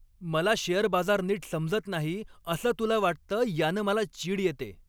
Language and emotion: Marathi, angry